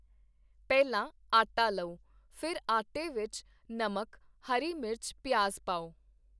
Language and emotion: Punjabi, neutral